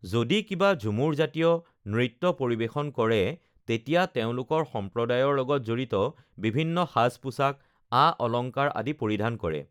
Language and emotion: Assamese, neutral